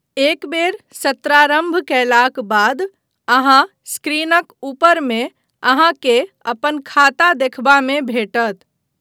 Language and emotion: Maithili, neutral